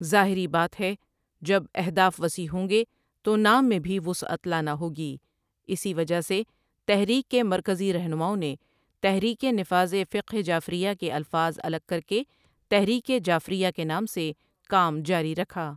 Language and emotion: Urdu, neutral